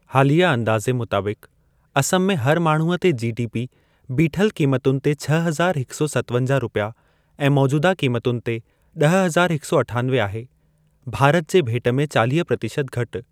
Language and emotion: Sindhi, neutral